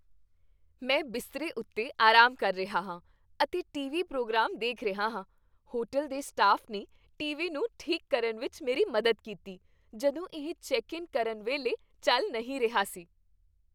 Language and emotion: Punjabi, happy